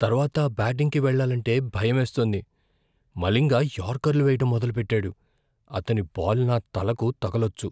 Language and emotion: Telugu, fearful